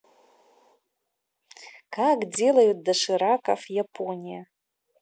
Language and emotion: Russian, positive